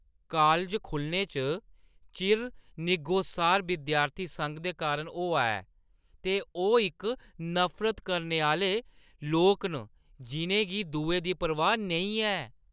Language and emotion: Dogri, disgusted